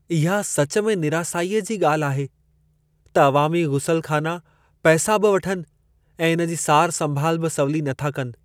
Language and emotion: Sindhi, sad